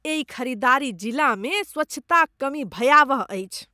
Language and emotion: Maithili, disgusted